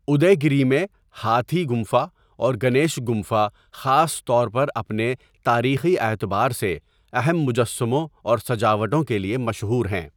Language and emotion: Urdu, neutral